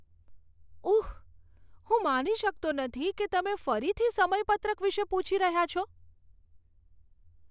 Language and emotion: Gujarati, disgusted